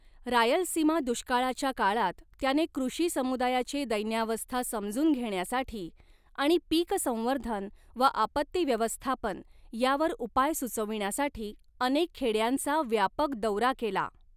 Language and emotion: Marathi, neutral